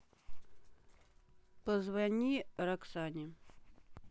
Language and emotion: Russian, neutral